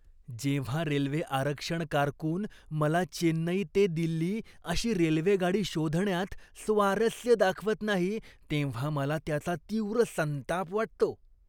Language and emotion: Marathi, disgusted